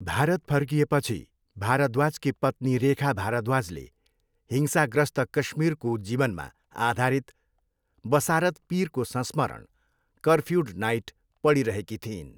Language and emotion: Nepali, neutral